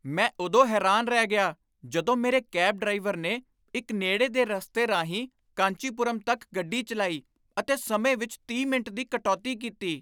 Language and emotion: Punjabi, surprised